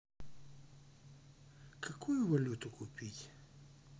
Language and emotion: Russian, neutral